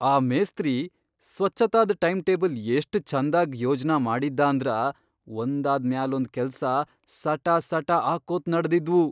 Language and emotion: Kannada, surprised